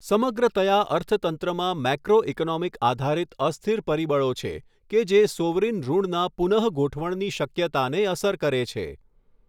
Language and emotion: Gujarati, neutral